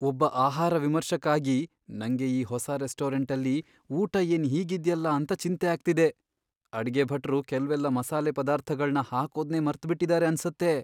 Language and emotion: Kannada, fearful